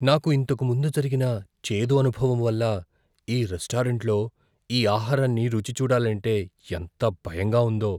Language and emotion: Telugu, fearful